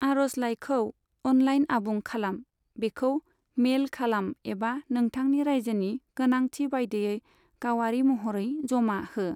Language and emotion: Bodo, neutral